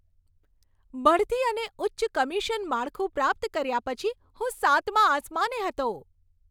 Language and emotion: Gujarati, happy